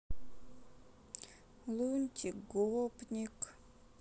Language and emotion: Russian, sad